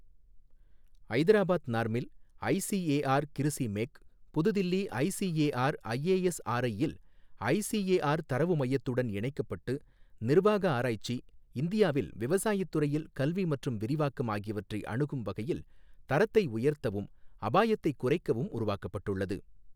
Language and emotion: Tamil, neutral